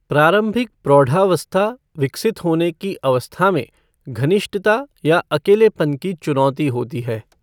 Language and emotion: Hindi, neutral